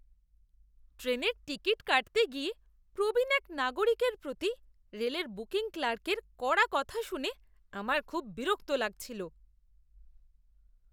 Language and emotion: Bengali, disgusted